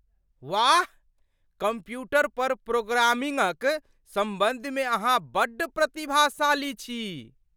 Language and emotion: Maithili, surprised